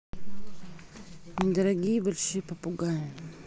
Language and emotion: Russian, neutral